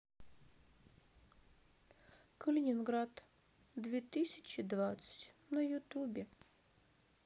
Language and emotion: Russian, sad